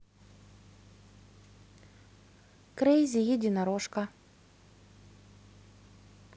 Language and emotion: Russian, neutral